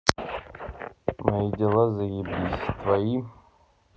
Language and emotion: Russian, neutral